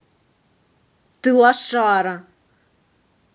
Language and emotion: Russian, angry